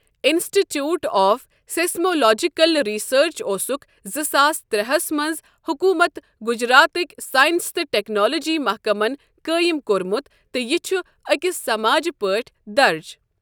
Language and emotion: Kashmiri, neutral